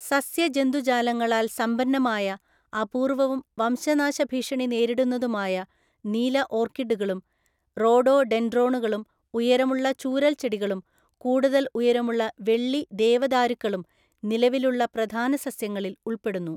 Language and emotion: Malayalam, neutral